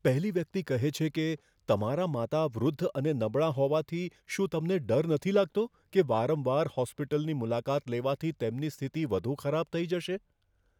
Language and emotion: Gujarati, fearful